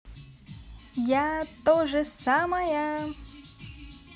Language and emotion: Russian, positive